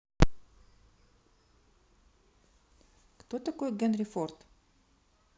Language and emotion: Russian, neutral